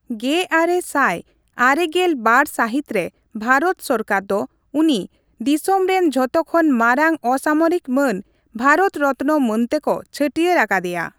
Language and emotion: Santali, neutral